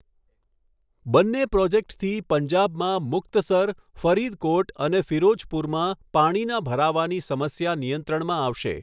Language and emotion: Gujarati, neutral